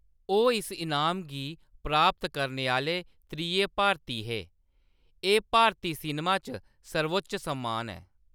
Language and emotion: Dogri, neutral